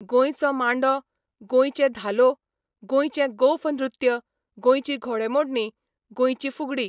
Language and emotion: Goan Konkani, neutral